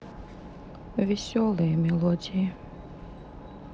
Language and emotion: Russian, sad